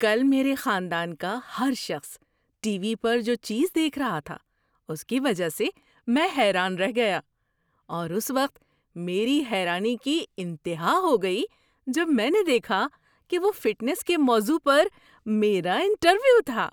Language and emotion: Urdu, surprised